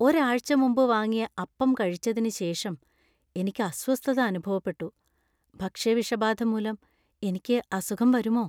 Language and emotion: Malayalam, fearful